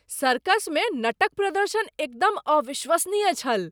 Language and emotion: Maithili, surprised